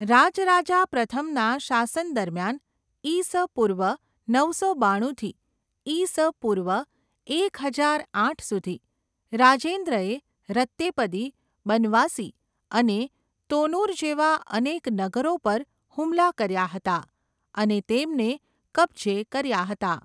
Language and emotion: Gujarati, neutral